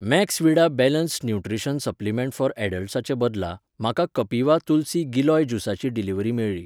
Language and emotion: Goan Konkani, neutral